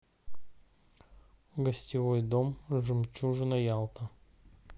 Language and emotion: Russian, neutral